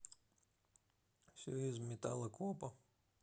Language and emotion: Russian, neutral